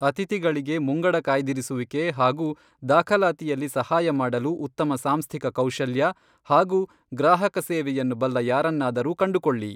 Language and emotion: Kannada, neutral